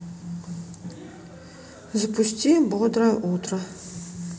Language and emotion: Russian, neutral